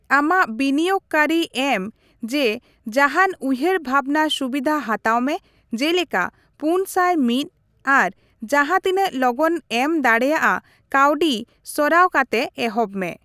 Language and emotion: Santali, neutral